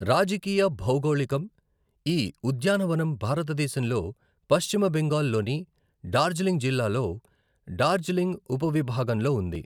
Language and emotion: Telugu, neutral